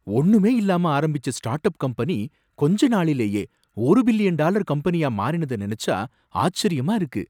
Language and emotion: Tamil, surprised